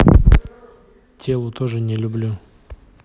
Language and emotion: Russian, neutral